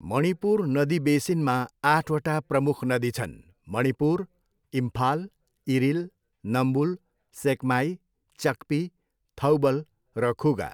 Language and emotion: Nepali, neutral